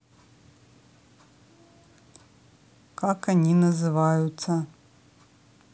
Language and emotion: Russian, neutral